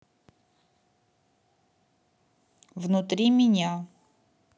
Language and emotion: Russian, neutral